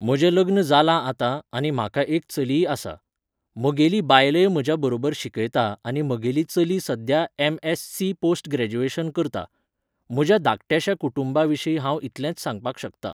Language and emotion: Goan Konkani, neutral